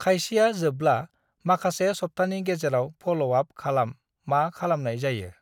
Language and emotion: Bodo, neutral